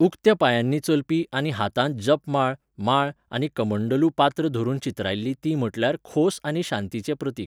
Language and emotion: Goan Konkani, neutral